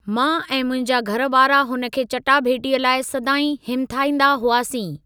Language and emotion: Sindhi, neutral